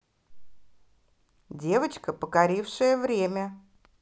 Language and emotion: Russian, positive